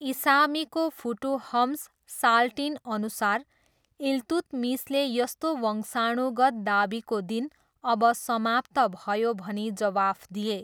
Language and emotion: Nepali, neutral